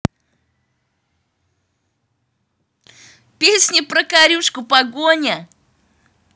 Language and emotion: Russian, positive